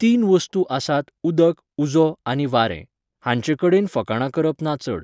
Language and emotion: Goan Konkani, neutral